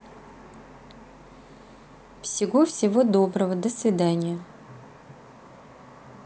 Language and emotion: Russian, neutral